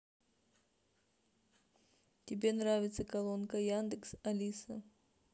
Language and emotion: Russian, neutral